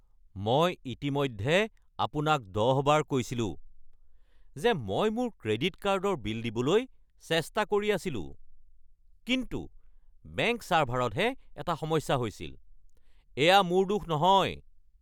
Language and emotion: Assamese, angry